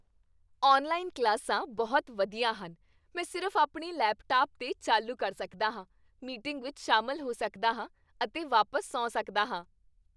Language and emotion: Punjabi, happy